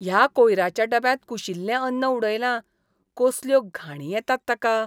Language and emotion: Goan Konkani, disgusted